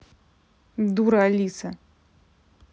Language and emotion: Russian, angry